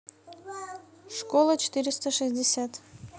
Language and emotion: Russian, neutral